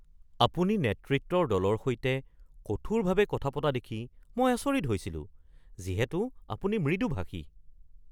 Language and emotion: Assamese, surprised